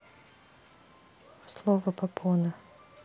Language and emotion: Russian, neutral